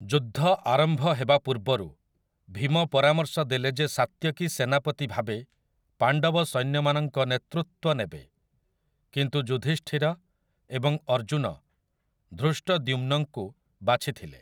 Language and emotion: Odia, neutral